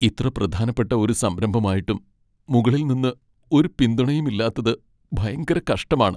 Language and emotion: Malayalam, sad